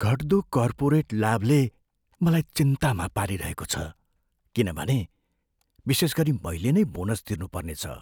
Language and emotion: Nepali, fearful